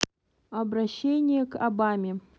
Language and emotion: Russian, neutral